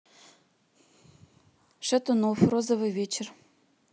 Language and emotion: Russian, neutral